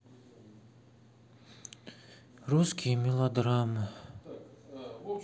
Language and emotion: Russian, sad